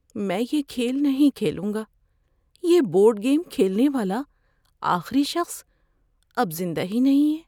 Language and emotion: Urdu, fearful